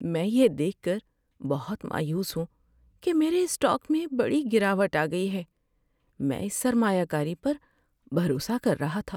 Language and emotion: Urdu, sad